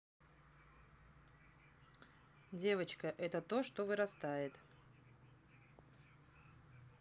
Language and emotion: Russian, neutral